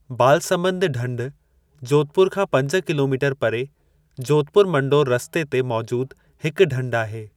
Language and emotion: Sindhi, neutral